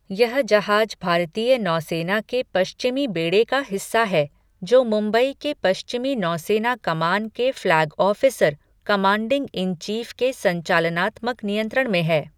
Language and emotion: Hindi, neutral